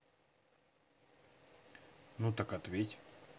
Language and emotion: Russian, neutral